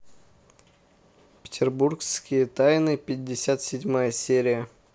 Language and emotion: Russian, neutral